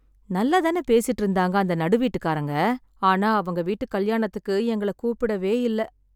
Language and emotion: Tamil, sad